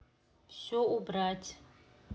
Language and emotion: Russian, neutral